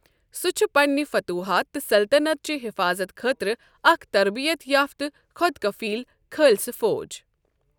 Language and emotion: Kashmiri, neutral